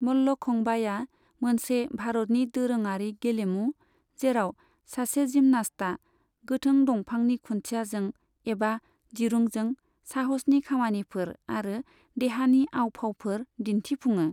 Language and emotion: Bodo, neutral